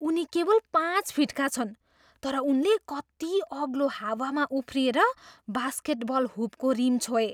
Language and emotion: Nepali, surprised